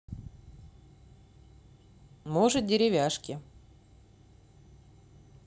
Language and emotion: Russian, neutral